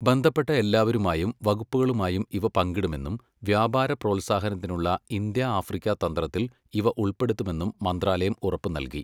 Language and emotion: Malayalam, neutral